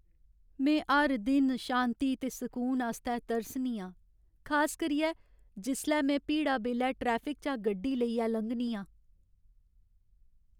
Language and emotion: Dogri, sad